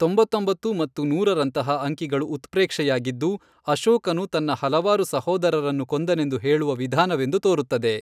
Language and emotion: Kannada, neutral